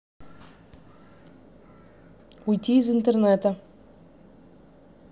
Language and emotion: Russian, neutral